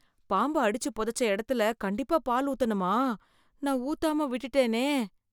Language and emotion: Tamil, fearful